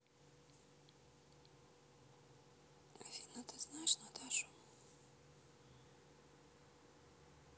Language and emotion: Russian, neutral